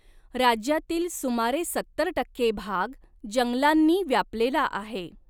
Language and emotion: Marathi, neutral